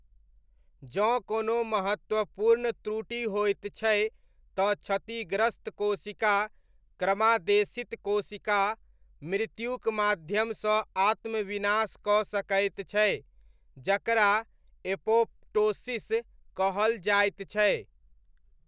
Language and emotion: Maithili, neutral